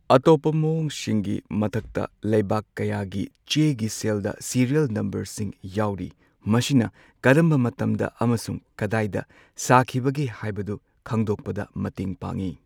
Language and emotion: Manipuri, neutral